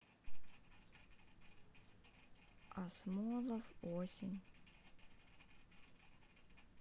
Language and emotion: Russian, sad